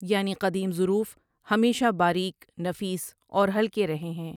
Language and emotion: Urdu, neutral